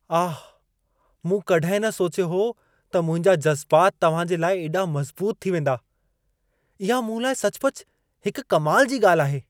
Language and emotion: Sindhi, surprised